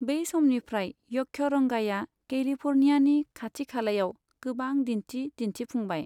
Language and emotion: Bodo, neutral